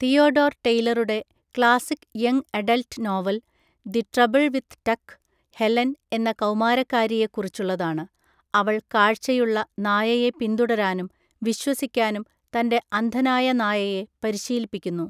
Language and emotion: Malayalam, neutral